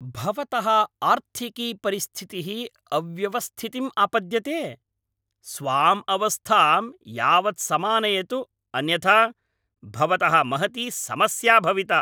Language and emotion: Sanskrit, angry